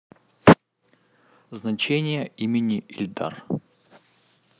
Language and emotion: Russian, neutral